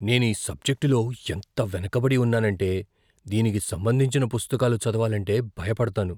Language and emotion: Telugu, fearful